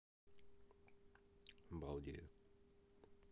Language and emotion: Russian, neutral